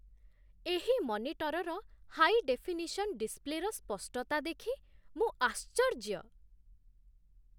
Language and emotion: Odia, surprised